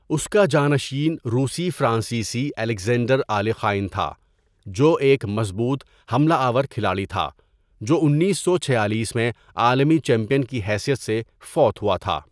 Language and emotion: Urdu, neutral